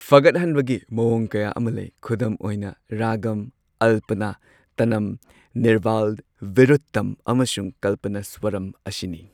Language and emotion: Manipuri, neutral